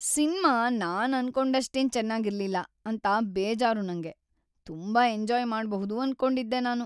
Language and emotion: Kannada, sad